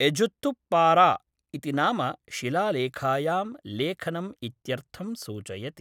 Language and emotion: Sanskrit, neutral